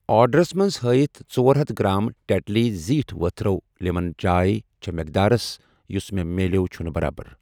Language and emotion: Kashmiri, neutral